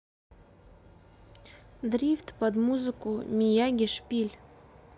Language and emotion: Russian, neutral